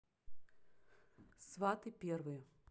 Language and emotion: Russian, neutral